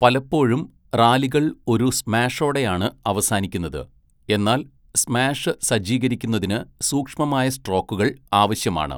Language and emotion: Malayalam, neutral